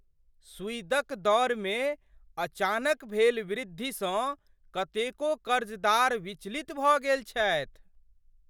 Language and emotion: Maithili, surprised